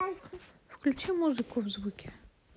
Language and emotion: Russian, neutral